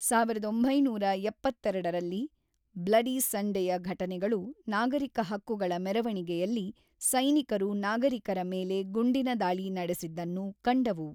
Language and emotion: Kannada, neutral